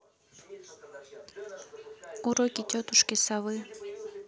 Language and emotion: Russian, neutral